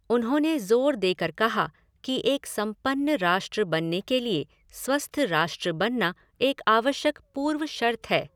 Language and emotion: Hindi, neutral